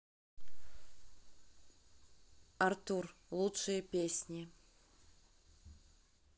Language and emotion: Russian, neutral